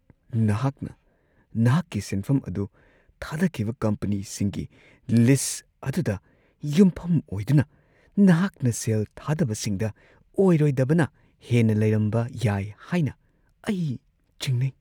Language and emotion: Manipuri, fearful